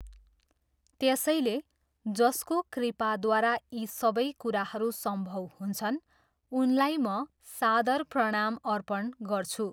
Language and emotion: Nepali, neutral